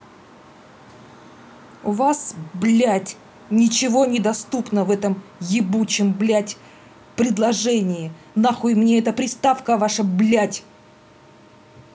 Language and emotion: Russian, angry